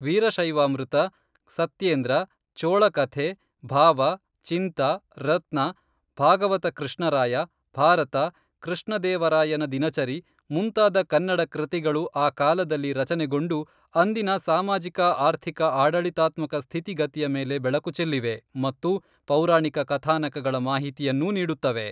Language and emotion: Kannada, neutral